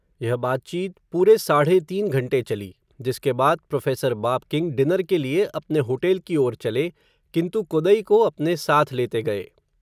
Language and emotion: Hindi, neutral